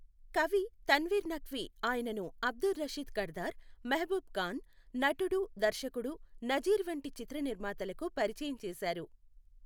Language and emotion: Telugu, neutral